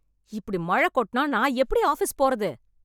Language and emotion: Tamil, angry